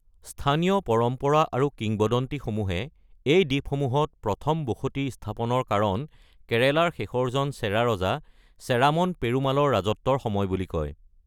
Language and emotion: Assamese, neutral